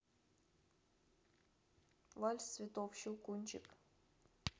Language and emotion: Russian, neutral